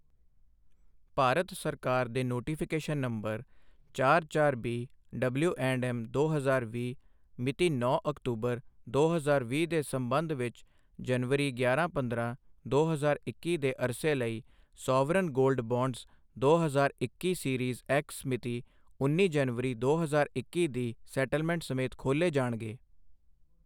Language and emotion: Punjabi, neutral